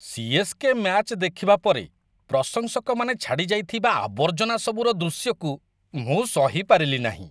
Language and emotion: Odia, disgusted